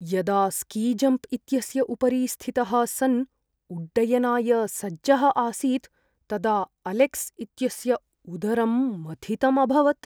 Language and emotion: Sanskrit, fearful